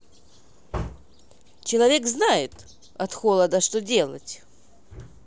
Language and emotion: Russian, positive